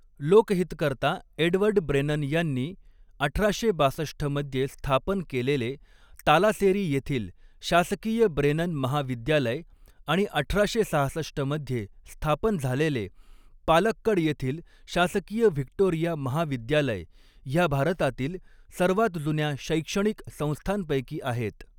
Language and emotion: Marathi, neutral